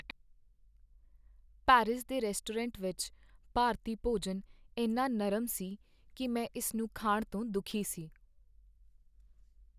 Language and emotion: Punjabi, sad